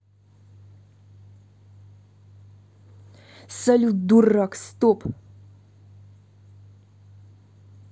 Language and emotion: Russian, angry